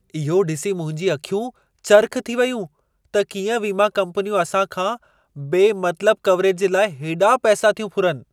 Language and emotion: Sindhi, surprised